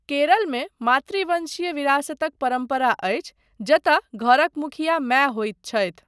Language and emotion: Maithili, neutral